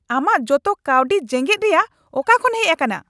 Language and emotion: Santali, angry